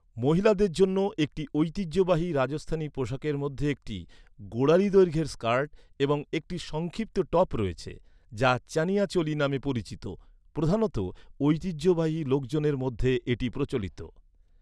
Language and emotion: Bengali, neutral